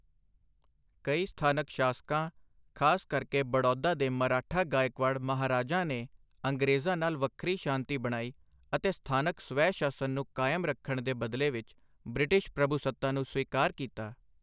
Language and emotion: Punjabi, neutral